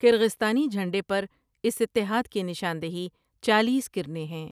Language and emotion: Urdu, neutral